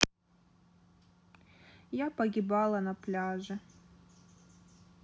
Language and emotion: Russian, sad